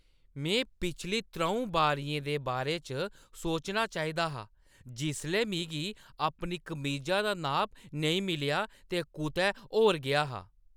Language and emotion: Dogri, angry